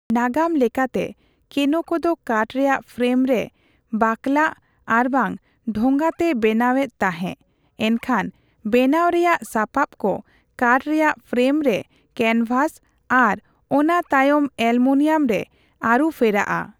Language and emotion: Santali, neutral